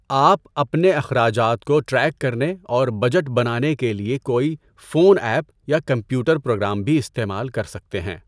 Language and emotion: Urdu, neutral